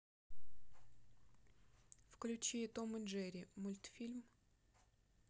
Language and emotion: Russian, neutral